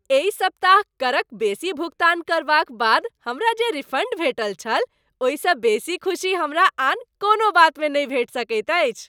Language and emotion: Maithili, happy